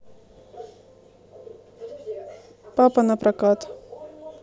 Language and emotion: Russian, neutral